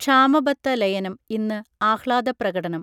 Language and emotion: Malayalam, neutral